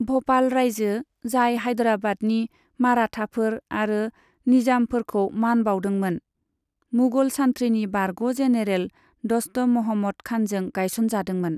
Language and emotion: Bodo, neutral